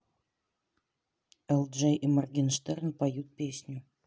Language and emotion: Russian, neutral